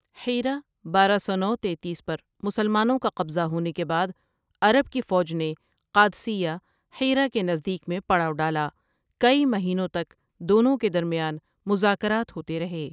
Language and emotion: Urdu, neutral